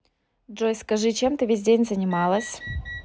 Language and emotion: Russian, neutral